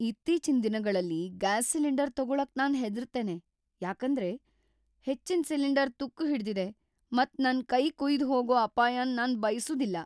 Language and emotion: Kannada, fearful